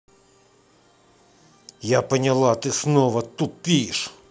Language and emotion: Russian, angry